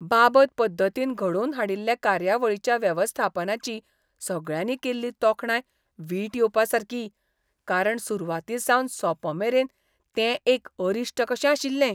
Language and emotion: Goan Konkani, disgusted